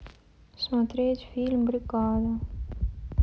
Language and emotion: Russian, sad